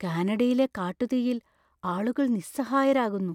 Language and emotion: Malayalam, fearful